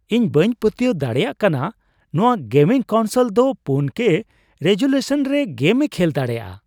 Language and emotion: Santali, surprised